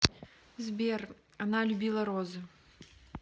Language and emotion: Russian, neutral